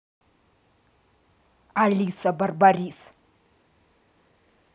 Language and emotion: Russian, angry